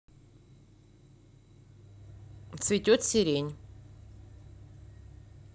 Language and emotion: Russian, neutral